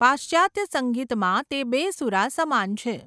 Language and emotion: Gujarati, neutral